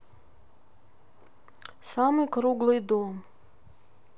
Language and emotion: Russian, neutral